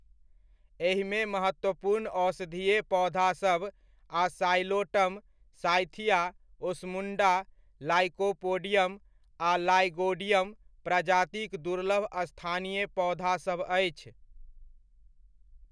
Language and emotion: Maithili, neutral